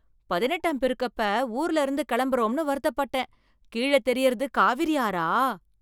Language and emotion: Tamil, surprised